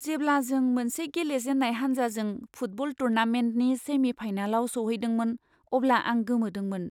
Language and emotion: Bodo, surprised